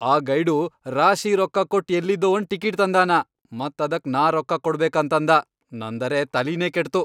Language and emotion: Kannada, angry